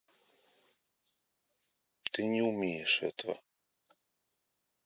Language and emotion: Russian, neutral